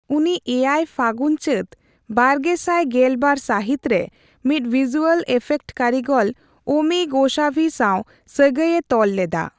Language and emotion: Santali, neutral